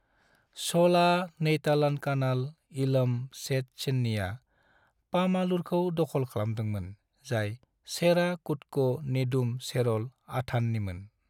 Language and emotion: Bodo, neutral